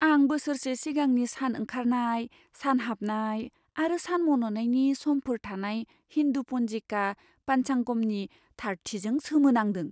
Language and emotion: Bodo, surprised